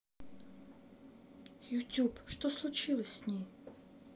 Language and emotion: Russian, sad